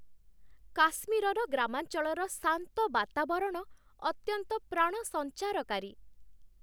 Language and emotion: Odia, happy